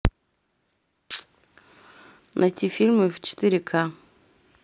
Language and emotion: Russian, neutral